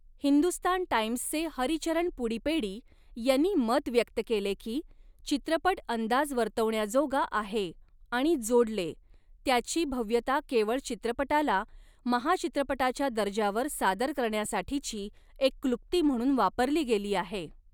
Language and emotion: Marathi, neutral